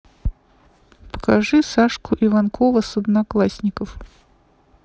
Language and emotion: Russian, neutral